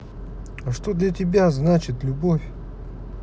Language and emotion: Russian, angry